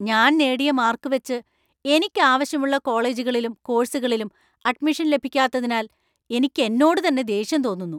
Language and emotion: Malayalam, angry